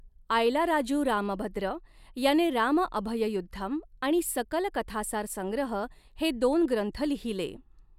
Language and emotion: Marathi, neutral